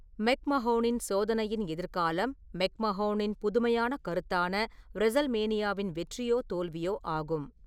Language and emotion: Tamil, neutral